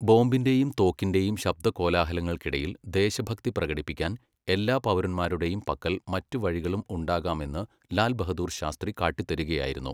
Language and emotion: Malayalam, neutral